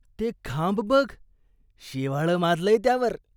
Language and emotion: Marathi, disgusted